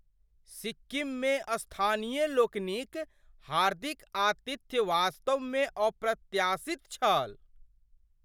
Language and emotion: Maithili, surprised